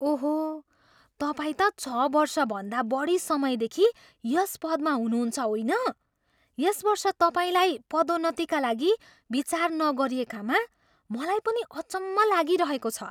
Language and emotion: Nepali, surprised